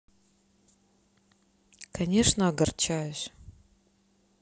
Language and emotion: Russian, sad